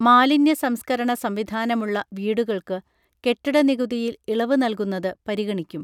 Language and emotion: Malayalam, neutral